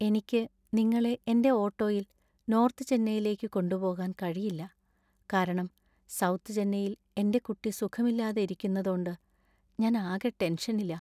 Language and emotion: Malayalam, sad